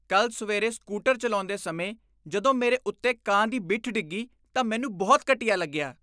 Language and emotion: Punjabi, disgusted